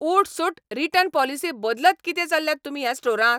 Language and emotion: Goan Konkani, angry